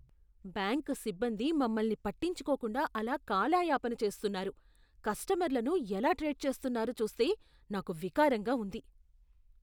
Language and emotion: Telugu, disgusted